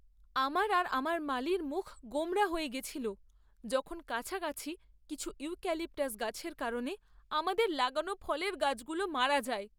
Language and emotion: Bengali, sad